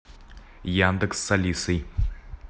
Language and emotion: Russian, neutral